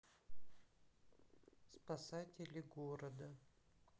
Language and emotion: Russian, sad